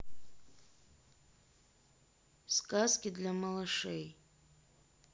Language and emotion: Russian, neutral